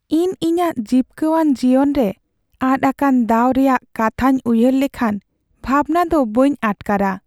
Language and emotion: Santali, sad